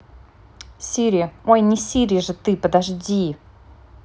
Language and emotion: Russian, neutral